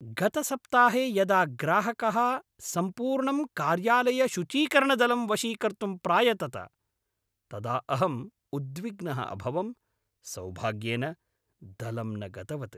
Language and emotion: Sanskrit, angry